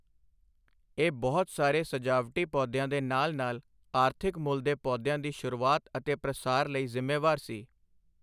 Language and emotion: Punjabi, neutral